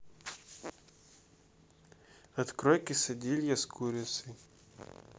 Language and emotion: Russian, neutral